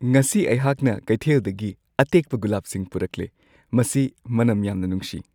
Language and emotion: Manipuri, happy